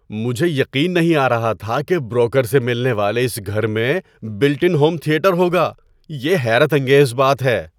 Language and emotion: Urdu, surprised